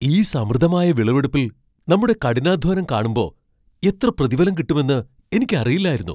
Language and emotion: Malayalam, surprised